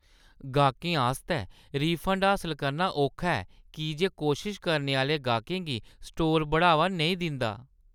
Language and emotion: Dogri, disgusted